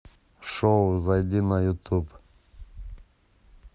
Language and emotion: Russian, neutral